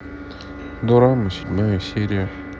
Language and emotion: Russian, sad